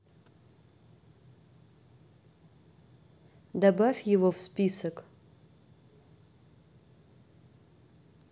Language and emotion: Russian, neutral